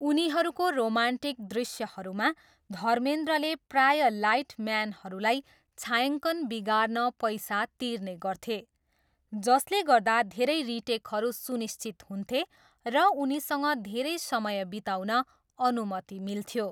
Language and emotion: Nepali, neutral